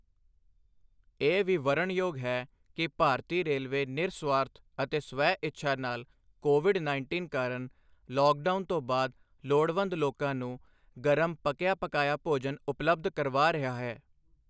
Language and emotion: Punjabi, neutral